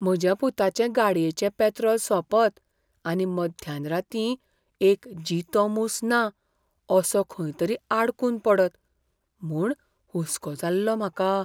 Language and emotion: Goan Konkani, fearful